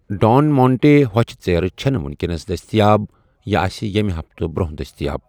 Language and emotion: Kashmiri, neutral